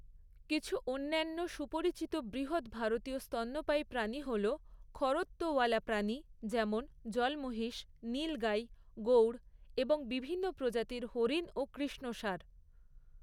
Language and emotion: Bengali, neutral